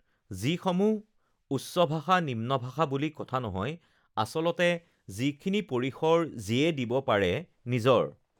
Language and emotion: Assamese, neutral